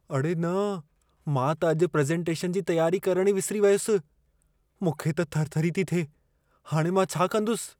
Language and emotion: Sindhi, fearful